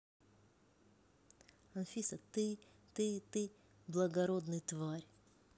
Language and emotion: Russian, neutral